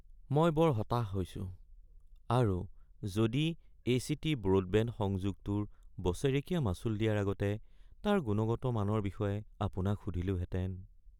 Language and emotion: Assamese, sad